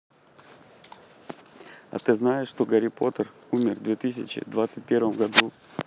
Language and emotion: Russian, neutral